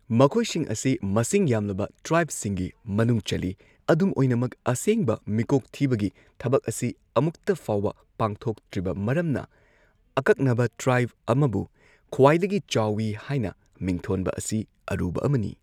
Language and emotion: Manipuri, neutral